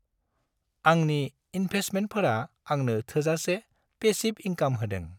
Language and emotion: Bodo, happy